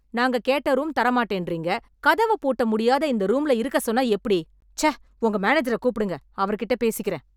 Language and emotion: Tamil, angry